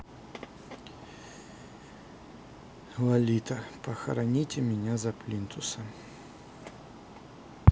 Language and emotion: Russian, sad